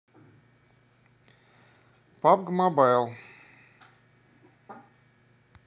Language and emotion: Russian, neutral